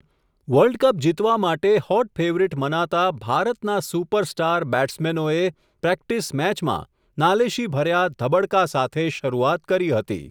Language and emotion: Gujarati, neutral